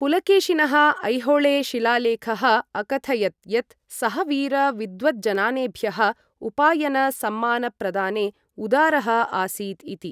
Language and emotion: Sanskrit, neutral